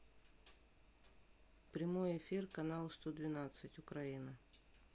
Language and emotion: Russian, neutral